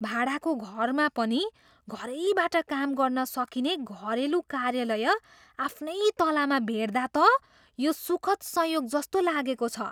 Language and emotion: Nepali, surprised